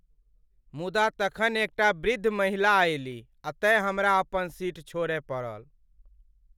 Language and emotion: Maithili, sad